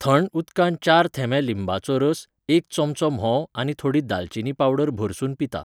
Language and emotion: Goan Konkani, neutral